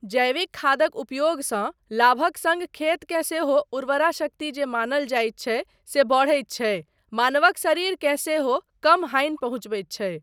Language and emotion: Maithili, neutral